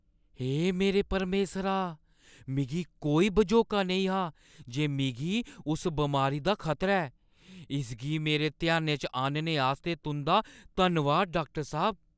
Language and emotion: Dogri, surprised